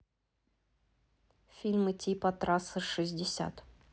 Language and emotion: Russian, neutral